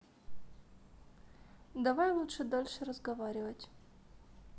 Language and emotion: Russian, neutral